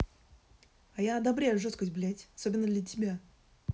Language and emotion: Russian, angry